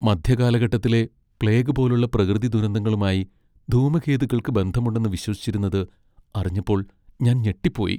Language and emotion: Malayalam, sad